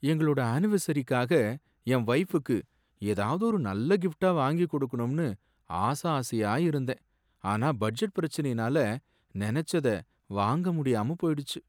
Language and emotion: Tamil, sad